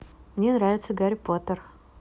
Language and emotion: Russian, positive